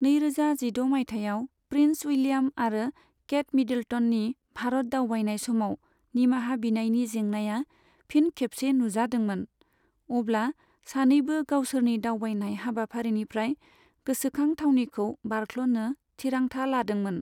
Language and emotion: Bodo, neutral